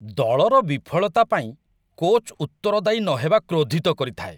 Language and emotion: Odia, disgusted